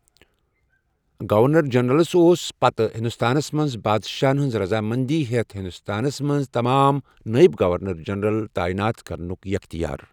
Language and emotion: Kashmiri, neutral